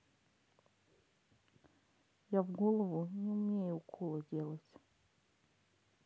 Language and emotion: Russian, sad